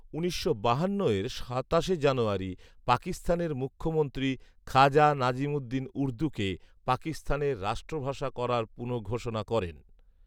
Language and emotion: Bengali, neutral